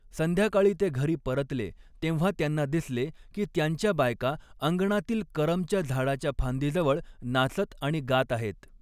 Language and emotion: Marathi, neutral